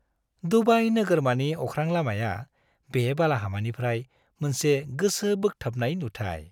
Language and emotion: Bodo, happy